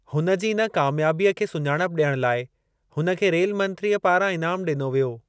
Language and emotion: Sindhi, neutral